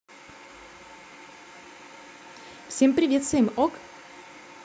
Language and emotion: Russian, positive